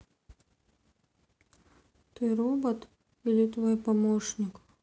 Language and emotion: Russian, sad